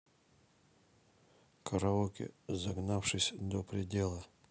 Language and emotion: Russian, neutral